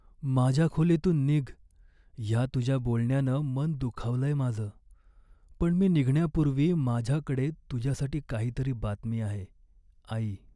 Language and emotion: Marathi, sad